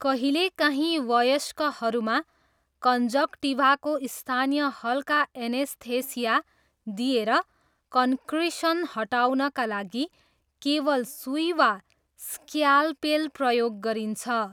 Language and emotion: Nepali, neutral